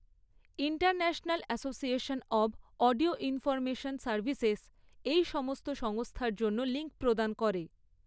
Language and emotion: Bengali, neutral